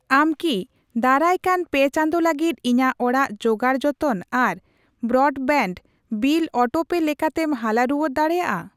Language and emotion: Santali, neutral